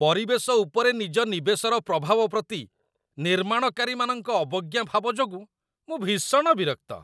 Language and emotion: Odia, disgusted